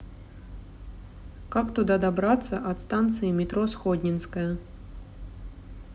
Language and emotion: Russian, neutral